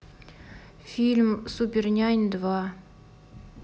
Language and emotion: Russian, neutral